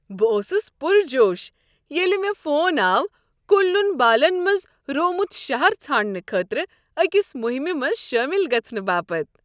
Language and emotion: Kashmiri, happy